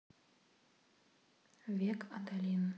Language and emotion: Russian, neutral